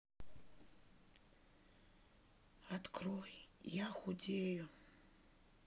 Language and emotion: Russian, neutral